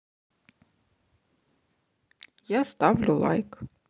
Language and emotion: Russian, neutral